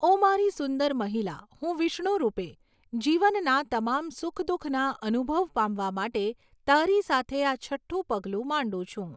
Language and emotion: Gujarati, neutral